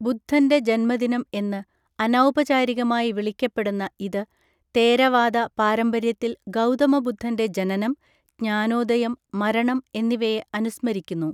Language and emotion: Malayalam, neutral